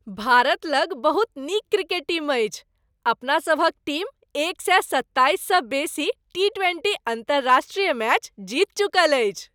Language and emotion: Maithili, happy